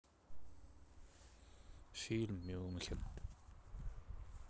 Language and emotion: Russian, sad